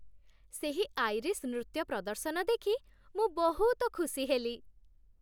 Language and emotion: Odia, happy